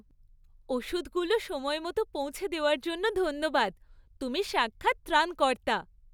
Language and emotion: Bengali, happy